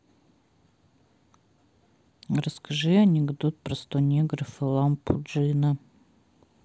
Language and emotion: Russian, neutral